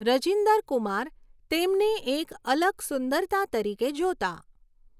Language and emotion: Gujarati, neutral